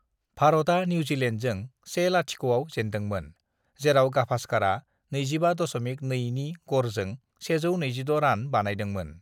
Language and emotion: Bodo, neutral